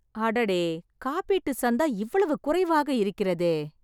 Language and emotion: Tamil, surprised